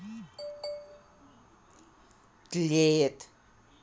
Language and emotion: Russian, neutral